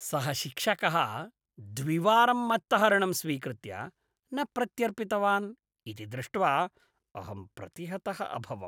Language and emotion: Sanskrit, disgusted